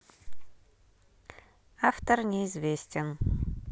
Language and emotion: Russian, neutral